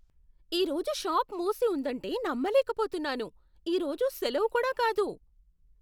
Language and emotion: Telugu, surprised